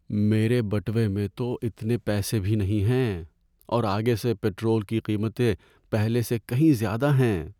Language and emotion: Urdu, sad